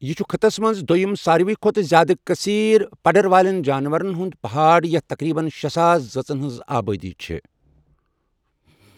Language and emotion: Kashmiri, neutral